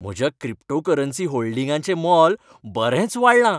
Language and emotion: Goan Konkani, happy